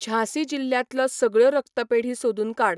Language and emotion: Goan Konkani, neutral